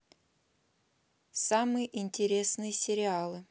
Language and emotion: Russian, neutral